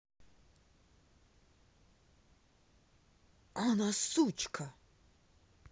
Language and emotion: Russian, angry